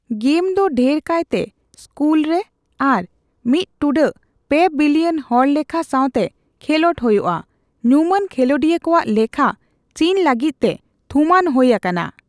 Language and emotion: Santali, neutral